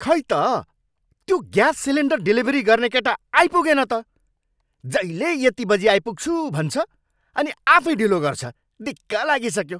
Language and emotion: Nepali, angry